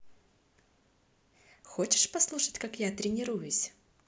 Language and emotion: Russian, positive